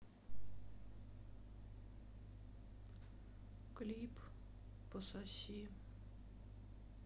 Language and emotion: Russian, sad